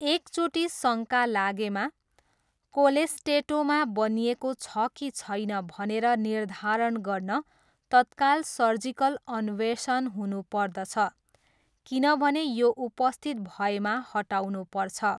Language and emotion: Nepali, neutral